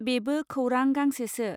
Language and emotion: Bodo, neutral